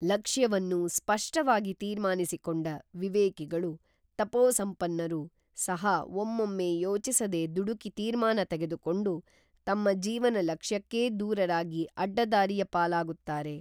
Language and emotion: Kannada, neutral